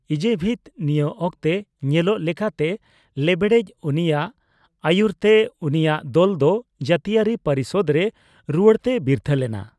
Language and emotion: Santali, neutral